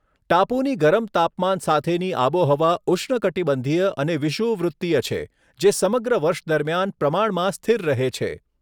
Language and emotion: Gujarati, neutral